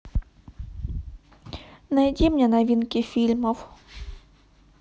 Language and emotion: Russian, neutral